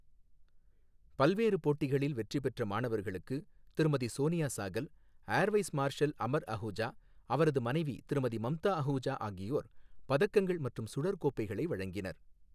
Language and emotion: Tamil, neutral